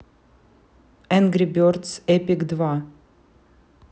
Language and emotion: Russian, neutral